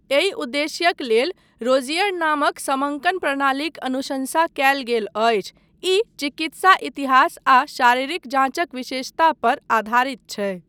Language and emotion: Maithili, neutral